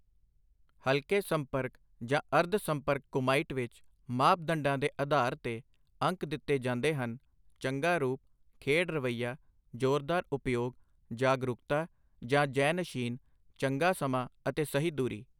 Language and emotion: Punjabi, neutral